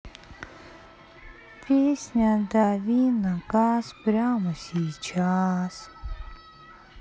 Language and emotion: Russian, sad